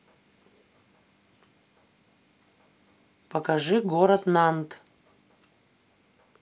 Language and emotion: Russian, neutral